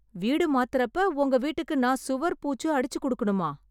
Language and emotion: Tamil, surprised